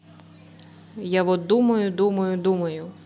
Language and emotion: Russian, neutral